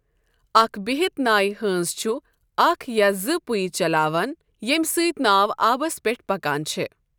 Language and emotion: Kashmiri, neutral